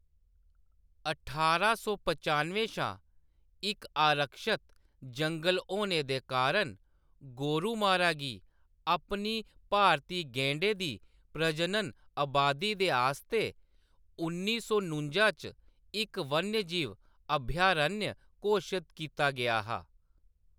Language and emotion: Dogri, neutral